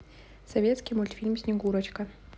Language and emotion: Russian, neutral